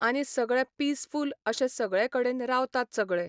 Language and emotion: Goan Konkani, neutral